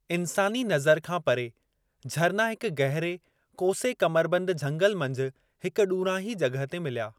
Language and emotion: Sindhi, neutral